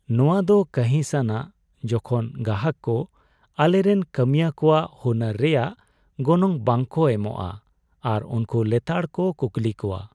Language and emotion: Santali, sad